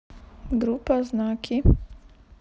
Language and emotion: Russian, neutral